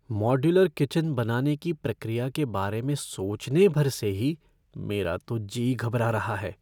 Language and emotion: Hindi, fearful